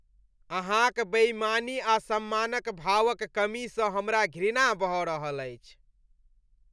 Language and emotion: Maithili, disgusted